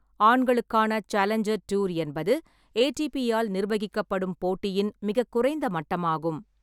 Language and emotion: Tamil, neutral